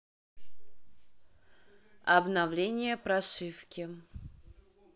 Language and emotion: Russian, neutral